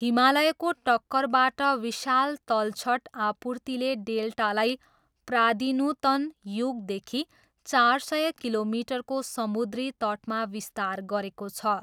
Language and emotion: Nepali, neutral